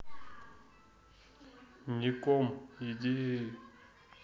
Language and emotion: Russian, neutral